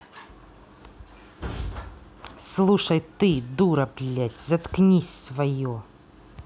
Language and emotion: Russian, angry